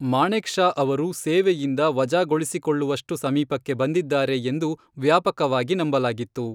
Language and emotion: Kannada, neutral